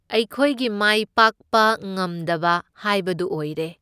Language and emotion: Manipuri, neutral